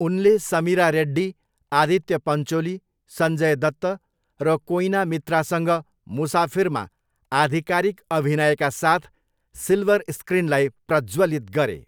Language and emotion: Nepali, neutral